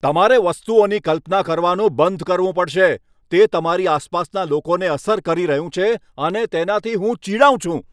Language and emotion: Gujarati, angry